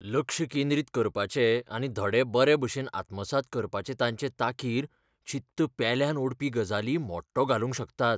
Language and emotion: Goan Konkani, fearful